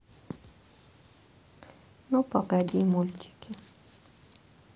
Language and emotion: Russian, sad